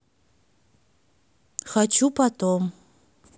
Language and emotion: Russian, neutral